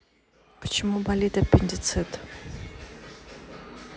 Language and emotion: Russian, neutral